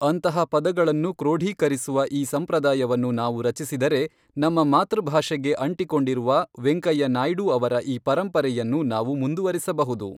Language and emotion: Kannada, neutral